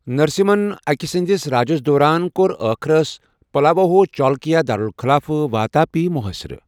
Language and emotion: Kashmiri, neutral